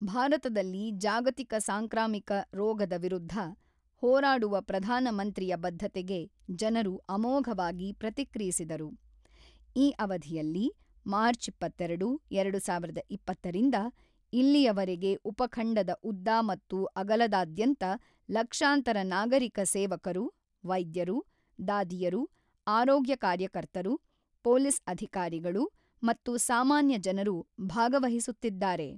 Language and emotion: Kannada, neutral